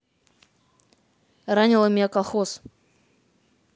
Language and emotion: Russian, neutral